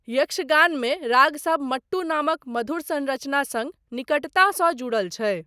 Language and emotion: Maithili, neutral